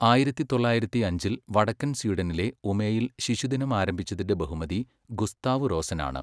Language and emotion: Malayalam, neutral